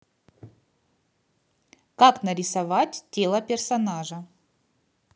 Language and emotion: Russian, positive